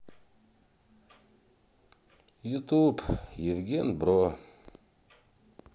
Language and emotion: Russian, sad